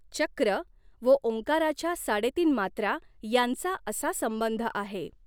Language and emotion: Marathi, neutral